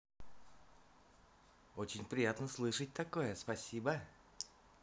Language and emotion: Russian, positive